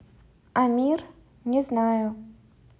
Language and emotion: Russian, neutral